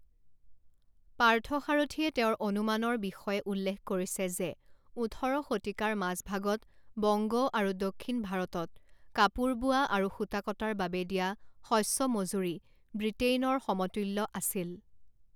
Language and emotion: Assamese, neutral